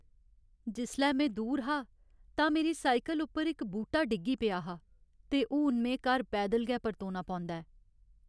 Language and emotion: Dogri, sad